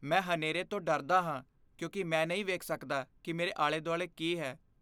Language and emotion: Punjabi, fearful